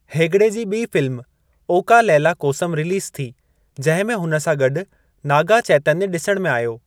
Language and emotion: Sindhi, neutral